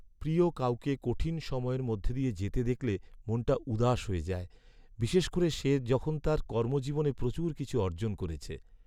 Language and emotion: Bengali, sad